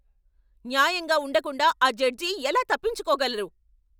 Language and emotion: Telugu, angry